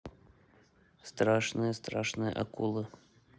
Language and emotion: Russian, neutral